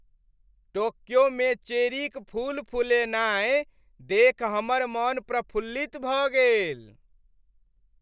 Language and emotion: Maithili, happy